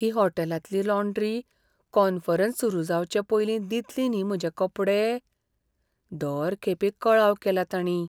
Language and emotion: Goan Konkani, fearful